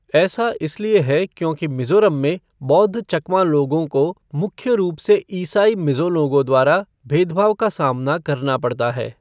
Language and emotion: Hindi, neutral